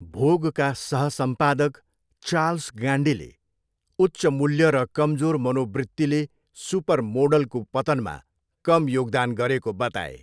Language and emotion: Nepali, neutral